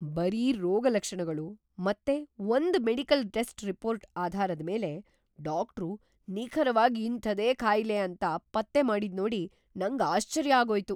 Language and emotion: Kannada, surprised